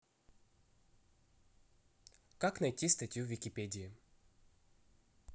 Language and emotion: Russian, neutral